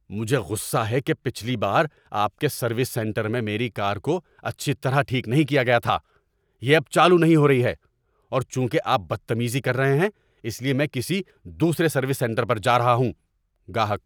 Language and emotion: Urdu, angry